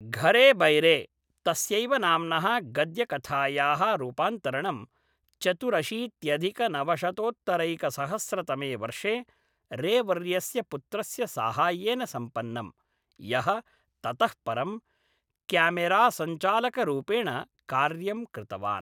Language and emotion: Sanskrit, neutral